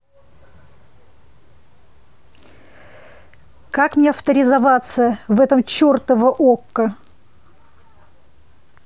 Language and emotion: Russian, angry